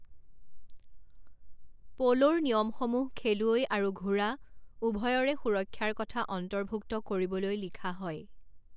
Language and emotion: Assamese, neutral